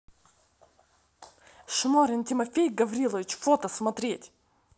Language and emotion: Russian, angry